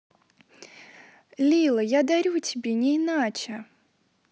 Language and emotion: Russian, positive